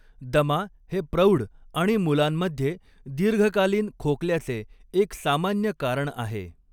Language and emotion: Marathi, neutral